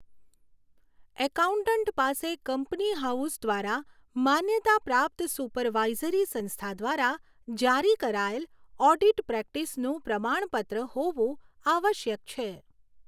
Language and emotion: Gujarati, neutral